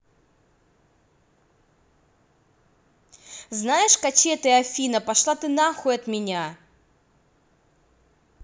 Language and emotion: Russian, angry